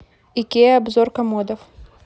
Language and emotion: Russian, neutral